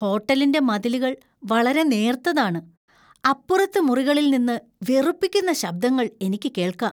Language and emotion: Malayalam, disgusted